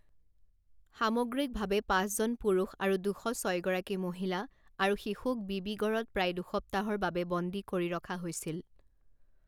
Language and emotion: Assamese, neutral